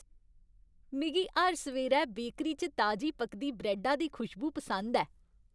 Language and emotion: Dogri, happy